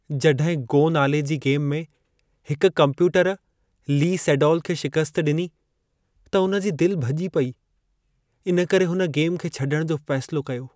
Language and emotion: Sindhi, sad